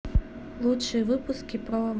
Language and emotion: Russian, neutral